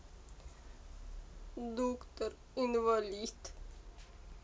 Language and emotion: Russian, sad